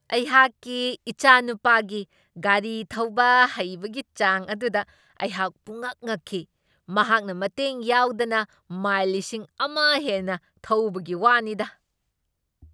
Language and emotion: Manipuri, surprised